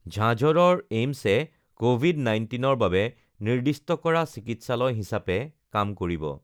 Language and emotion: Assamese, neutral